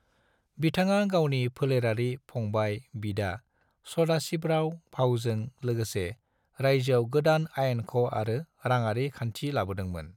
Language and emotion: Bodo, neutral